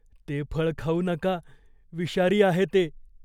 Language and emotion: Marathi, fearful